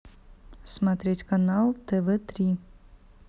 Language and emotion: Russian, neutral